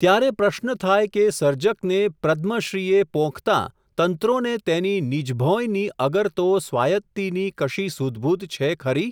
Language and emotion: Gujarati, neutral